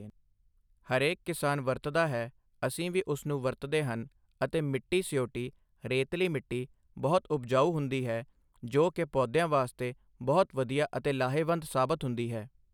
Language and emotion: Punjabi, neutral